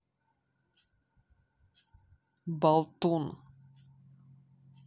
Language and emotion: Russian, angry